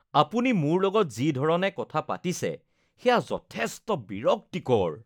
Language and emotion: Assamese, disgusted